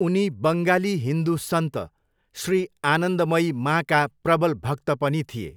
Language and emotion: Nepali, neutral